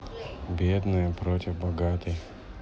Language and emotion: Russian, sad